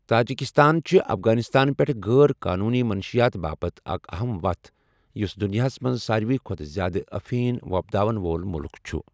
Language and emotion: Kashmiri, neutral